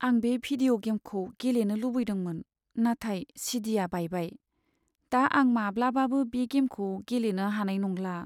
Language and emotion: Bodo, sad